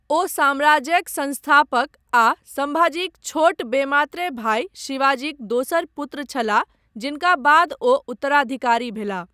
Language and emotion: Maithili, neutral